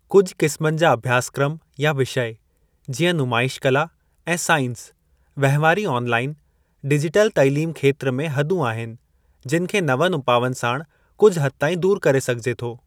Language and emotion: Sindhi, neutral